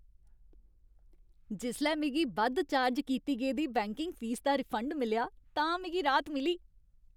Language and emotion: Dogri, happy